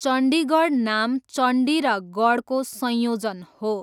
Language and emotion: Nepali, neutral